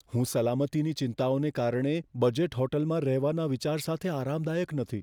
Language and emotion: Gujarati, fearful